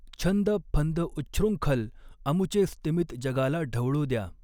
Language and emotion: Marathi, neutral